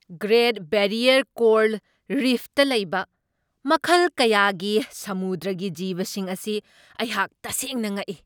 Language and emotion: Manipuri, surprised